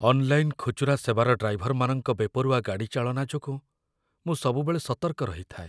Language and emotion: Odia, fearful